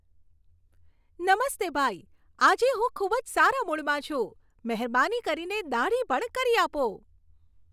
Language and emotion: Gujarati, happy